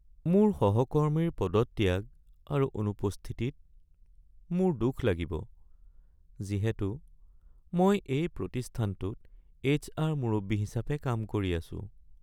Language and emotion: Assamese, sad